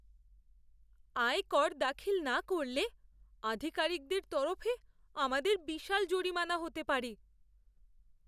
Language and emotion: Bengali, fearful